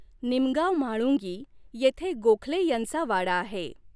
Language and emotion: Marathi, neutral